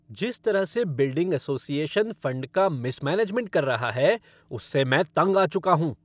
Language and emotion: Hindi, angry